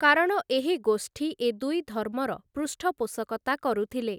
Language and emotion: Odia, neutral